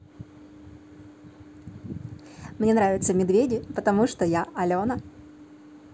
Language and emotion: Russian, positive